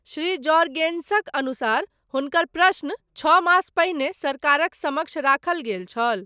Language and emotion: Maithili, neutral